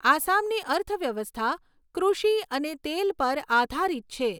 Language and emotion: Gujarati, neutral